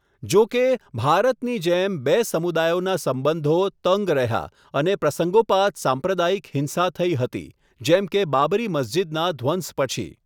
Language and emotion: Gujarati, neutral